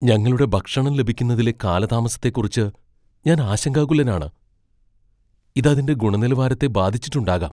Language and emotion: Malayalam, fearful